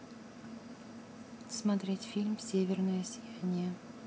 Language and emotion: Russian, neutral